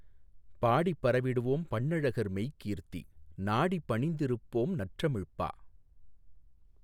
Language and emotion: Tamil, neutral